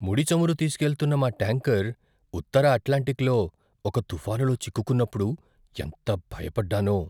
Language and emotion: Telugu, fearful